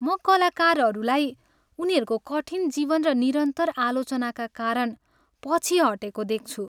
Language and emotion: Nepali, sad